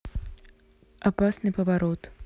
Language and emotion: Russian, neutral